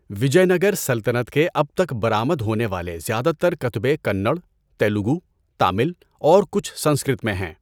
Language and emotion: Urdu, neutral